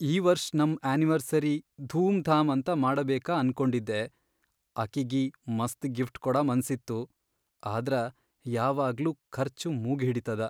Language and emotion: Kannada, sad